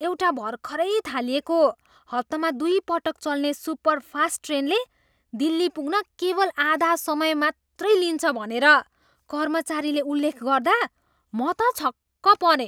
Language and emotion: Nepali, surprised